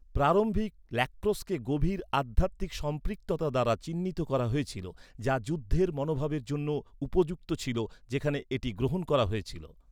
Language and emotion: Bengali, neutral